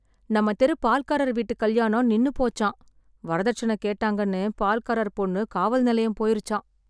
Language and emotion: Tamil, sad